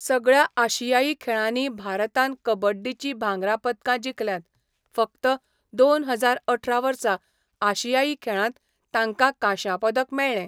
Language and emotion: Goan Konkani, neutral